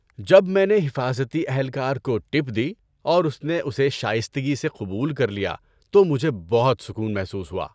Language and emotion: Urdu, happy